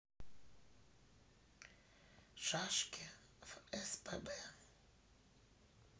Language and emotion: Russian, neutral